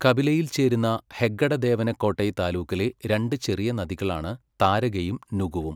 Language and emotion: Malayalam, neutral